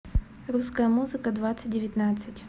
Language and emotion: Russian, neutral